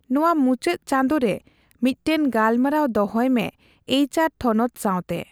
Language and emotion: Santali, neutral